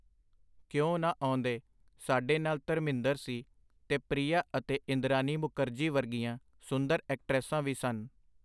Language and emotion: Punjabi, neutral